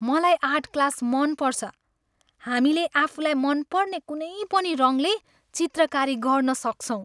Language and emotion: Nepali, happy